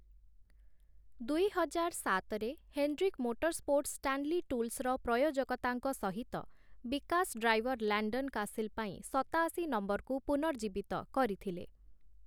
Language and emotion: Odia, neutral